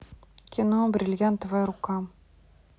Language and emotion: Russian, neutral